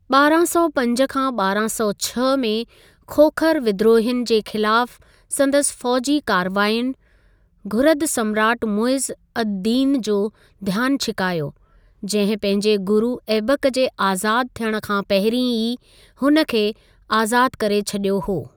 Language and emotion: Sindhi, neutral